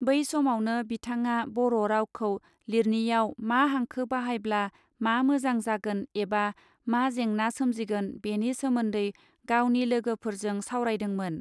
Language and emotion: Bodo, neutral